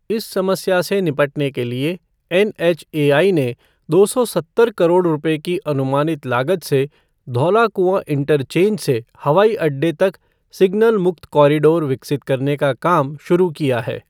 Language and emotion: Hindi, neutral